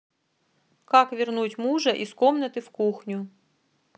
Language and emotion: Russian, neutral